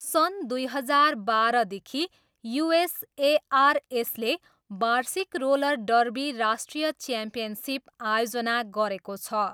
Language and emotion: Nepali, neutral